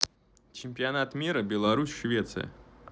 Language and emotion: Russian, neutral